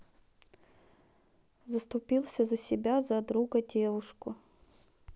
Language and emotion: Russian, neutral